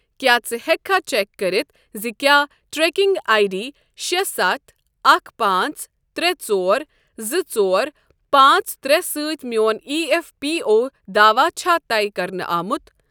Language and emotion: Kashmiri, neutral